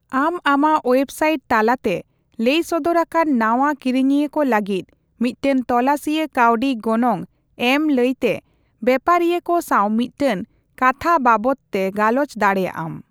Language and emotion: Santali, neutral